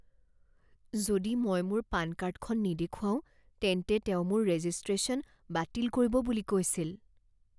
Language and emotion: Assamese, fearful